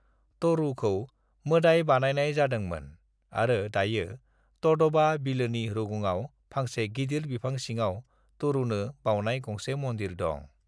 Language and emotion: Bodo, neutral